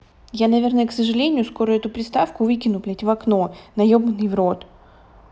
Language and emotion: Russian, angry